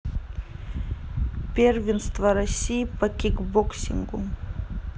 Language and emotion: Russian, neutral